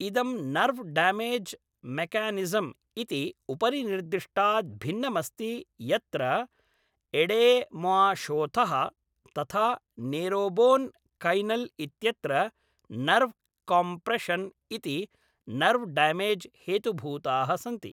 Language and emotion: Sanskrit, neutral